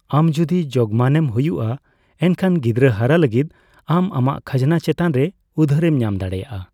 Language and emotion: Santali, neutral